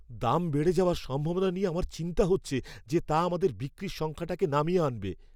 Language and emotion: Bengali, fearful